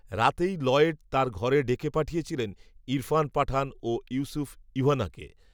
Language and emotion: Bengali, neutral